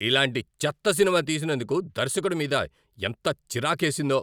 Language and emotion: Telugu, angry